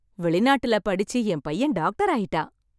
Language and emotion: Tamil, happy